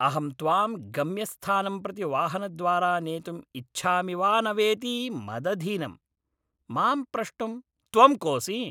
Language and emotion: Sanskrit, angry